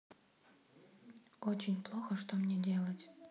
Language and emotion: Russian, sad